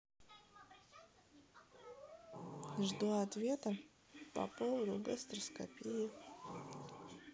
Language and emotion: Russian, neutral